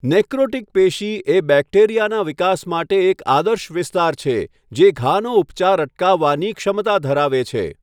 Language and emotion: Gujarati, neutral